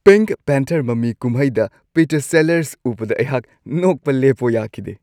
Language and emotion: Manipuri, happy